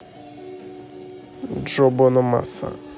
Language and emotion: Russian, neutral